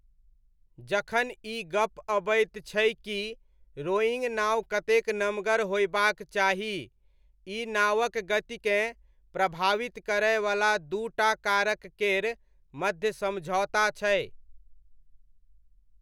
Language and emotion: Maithili, neutral